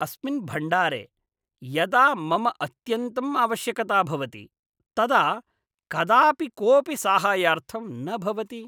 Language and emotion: Sanskrit, disgusted